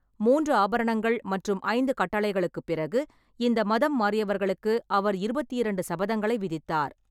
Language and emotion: Tamil, neutral